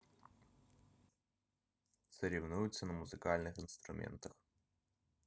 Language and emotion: Russian, neutral